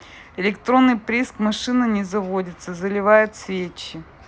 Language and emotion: Russian, neutral